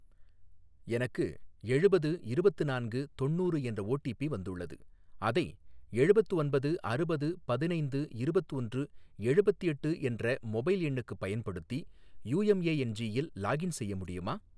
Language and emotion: Tamil, neutral